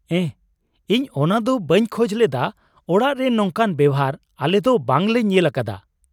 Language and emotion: Santali, surprised